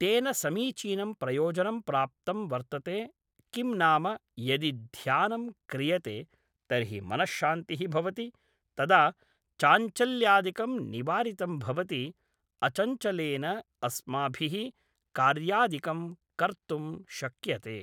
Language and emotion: Sanskrit, neutral